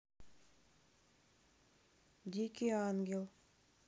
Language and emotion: Russian, neutral